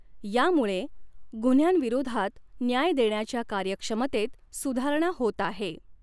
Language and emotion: Marathi, neutral